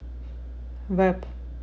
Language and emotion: Russian, neutral